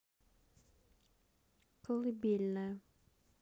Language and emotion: Russian, neutral